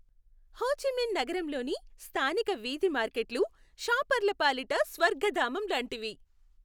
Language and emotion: Telugu, happy